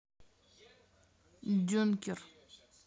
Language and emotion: Russian, neutral